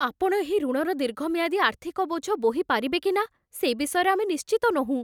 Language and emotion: Odia, fearful